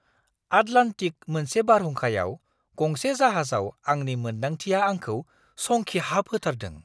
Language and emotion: Bodo, surprised